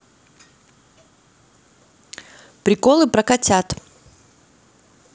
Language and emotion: Russian, neutral